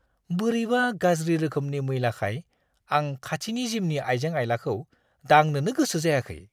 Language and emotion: Bodo, disgusted